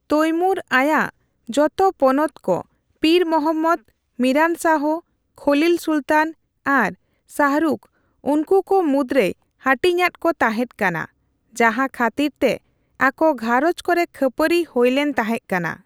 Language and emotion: Santali, neutral